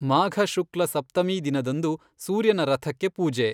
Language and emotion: Kannada, neutral